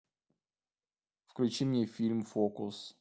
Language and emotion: Russian, neutral